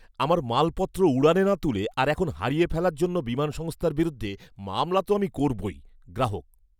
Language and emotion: Bengali, angry